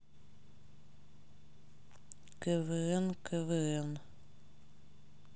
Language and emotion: Russian, sad